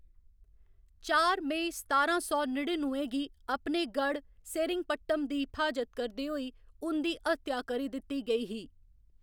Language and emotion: Dogri, neutral